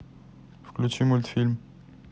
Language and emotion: Russian, neutral